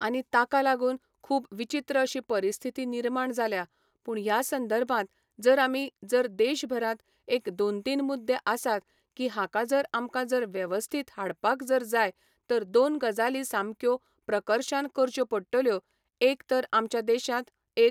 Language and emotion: Goan Konkani, neutral